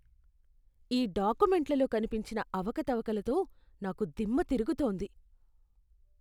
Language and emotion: Telugu, disgusted